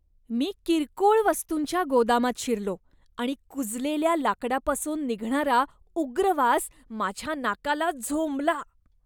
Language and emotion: Marathi, disgusted